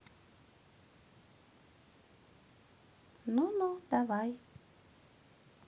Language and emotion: Russian, neutral